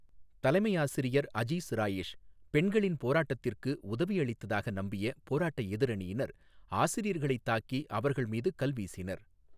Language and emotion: Tamil, neutral